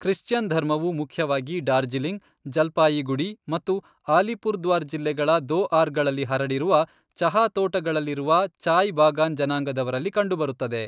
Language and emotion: Kannada, neutral